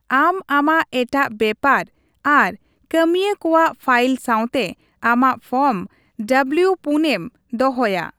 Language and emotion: Santali, neutral